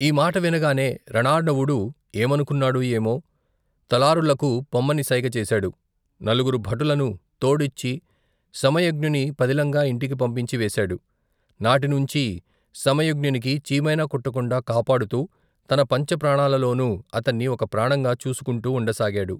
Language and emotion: Telugu, neutral